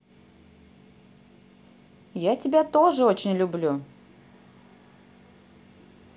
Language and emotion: Russian, positive